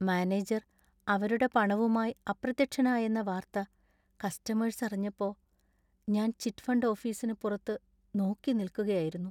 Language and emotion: Malayalam, sad